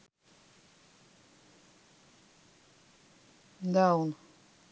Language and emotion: Russian, neutral